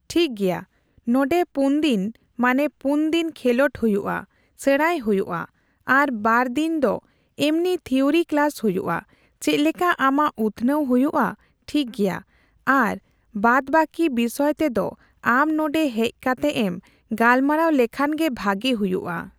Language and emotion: Santali, neutral